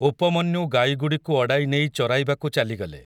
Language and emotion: Odia, neutral